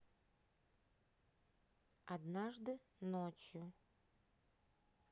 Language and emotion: Russian, neutral